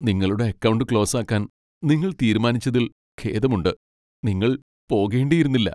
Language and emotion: Malayalam, sad